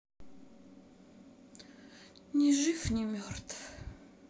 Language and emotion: Russian, sad